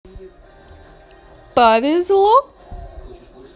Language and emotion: Russian, positive